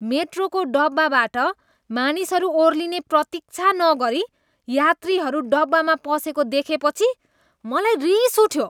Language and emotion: Nepali, disgusted